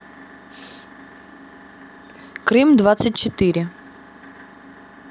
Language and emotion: Russian, neutral